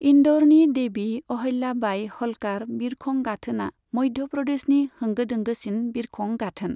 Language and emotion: Bodo, neutral